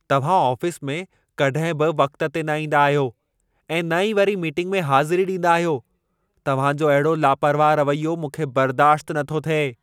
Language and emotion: Sindhi, angry